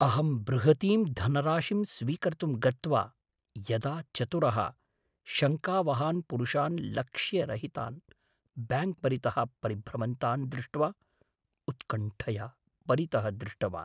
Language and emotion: Sanskrit, fearful